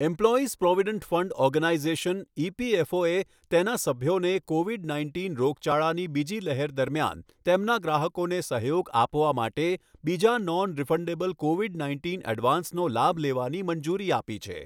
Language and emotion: Gujarati, neutral